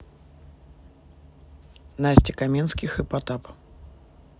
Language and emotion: Russian, neutral